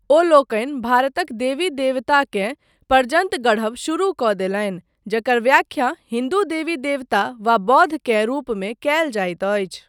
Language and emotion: Maithili, neutral